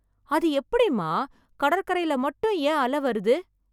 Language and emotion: Tamil, surprised